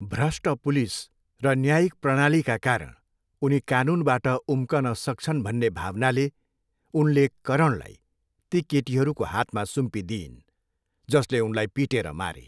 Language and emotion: Nepali, neutral